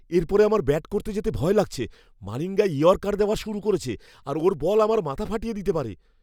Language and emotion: Bengali, fearful